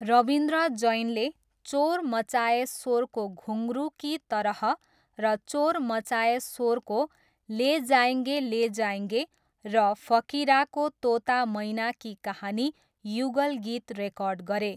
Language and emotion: Nepali, neutral